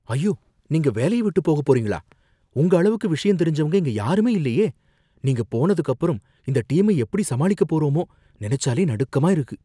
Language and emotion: Tamil, fearful